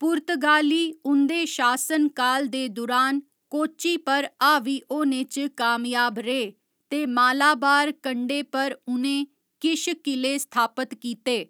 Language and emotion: Dogri, neutral